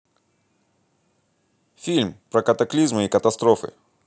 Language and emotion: Russian, neutral